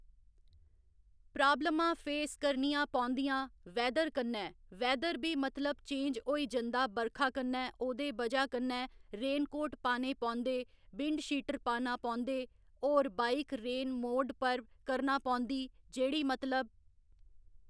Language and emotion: Dogri, neutral